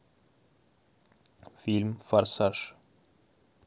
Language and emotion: Russian, neutral